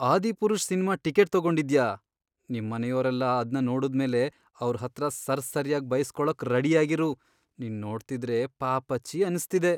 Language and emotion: Kannada, sad